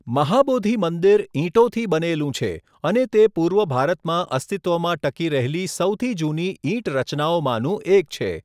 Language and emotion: Gujarati, neutral